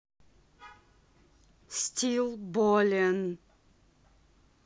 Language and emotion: Russian, angry